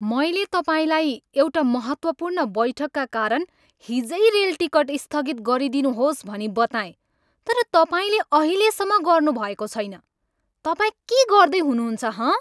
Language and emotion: Nepali, angry